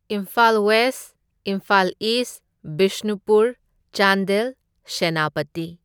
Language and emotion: Manipuri, neutral